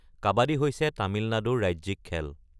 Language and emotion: Assamese, neutral